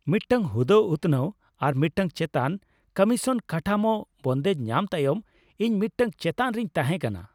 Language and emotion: Santali, happy